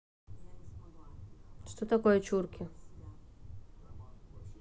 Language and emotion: Russian, neutral